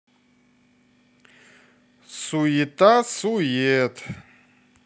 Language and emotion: Russian, neutral